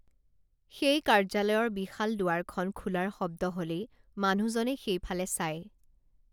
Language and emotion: Assamese, neutral